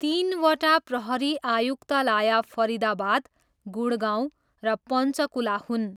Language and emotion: Nepali, neutral